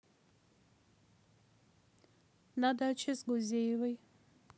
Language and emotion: Russian, neutral